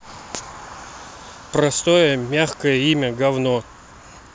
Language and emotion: Russian, neutral